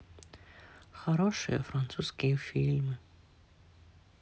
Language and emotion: Russian, sad